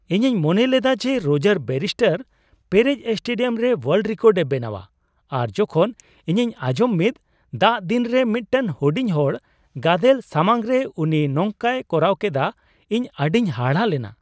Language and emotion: Santali, surprised